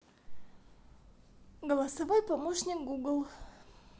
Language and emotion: Russian, neutral